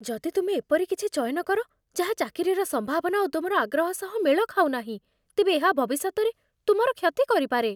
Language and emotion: Odia, fearful